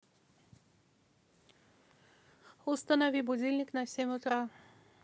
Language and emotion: Russian, neutral